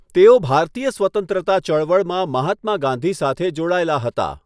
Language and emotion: Gujarati, neutral